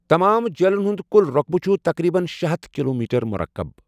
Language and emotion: Kashmiri, neutral